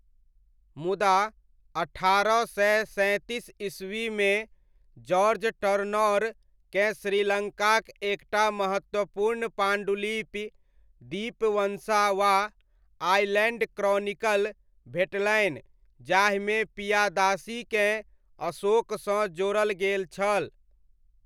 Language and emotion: Maithili, neutral